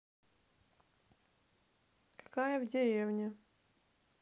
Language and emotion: Russian, neutral